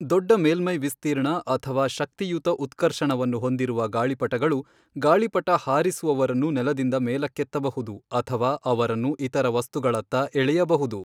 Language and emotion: Kannada, neutral